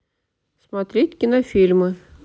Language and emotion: Russian, neutral